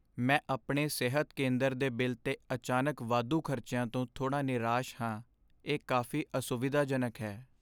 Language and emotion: Punjabi, sad